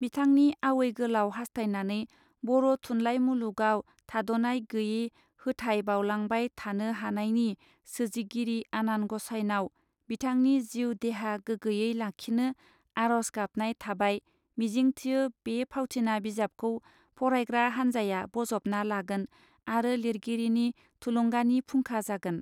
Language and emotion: Bodo, neutral